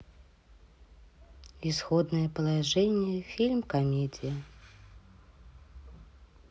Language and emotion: Russian, neutral